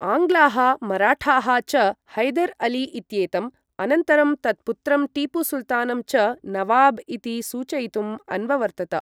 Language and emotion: Sanskrit, neutral